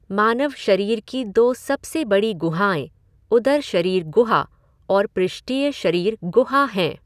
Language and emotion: Hindi, neutral